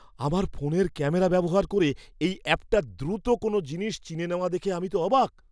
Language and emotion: Bengali, surprised